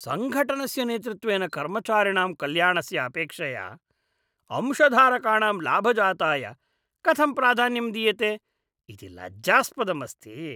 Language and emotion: Sanskrit, disgusted